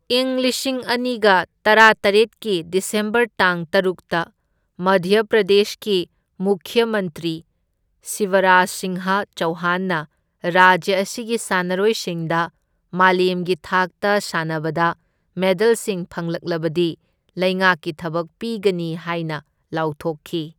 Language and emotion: Manipuri, neutral